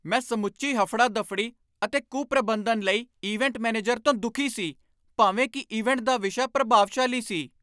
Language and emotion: Punjabi, angry